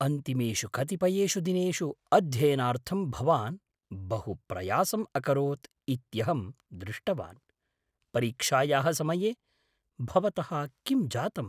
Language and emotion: Sanskrit, surprised